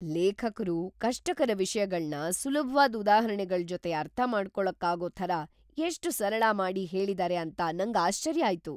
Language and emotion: Kannada, surprised